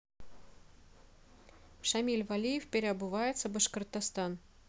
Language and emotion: Russian, neutral